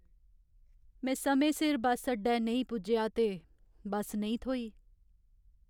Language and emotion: Dogri, sad